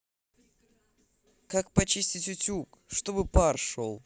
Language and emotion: Russian, neutral